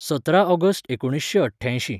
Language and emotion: Goan Konkani, neutral